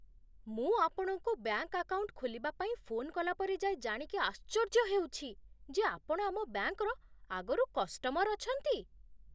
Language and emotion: Odia, surprised